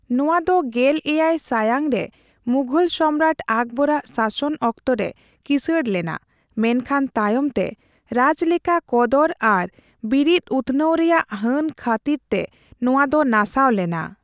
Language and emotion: Santali, neutral